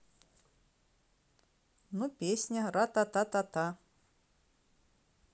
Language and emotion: Russian, neutral